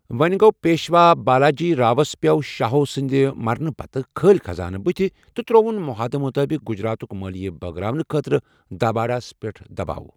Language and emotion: Kashmiri, neutral